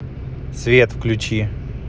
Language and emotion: Russian, neutral